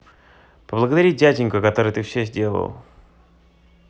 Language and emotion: Russian, neutral